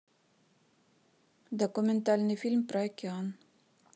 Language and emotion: Russian, neutral